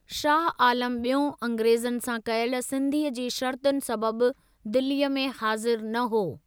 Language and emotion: Sindhi, neutral